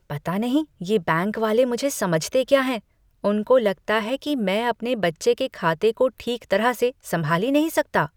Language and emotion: Hindi, disgusted